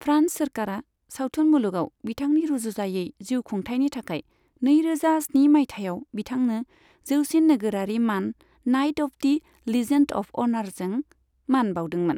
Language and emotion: Bodo, neutral